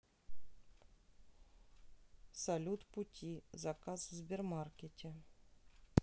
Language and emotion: Russian, neutral